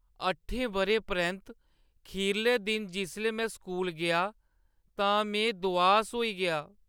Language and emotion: Dogri, sad